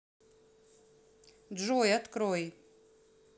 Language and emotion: Russian, neutral